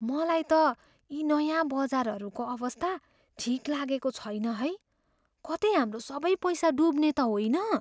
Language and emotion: Nepali, fearful